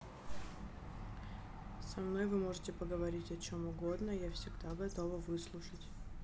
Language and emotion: Russian, neutral